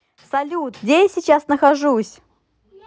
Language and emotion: Russian, positive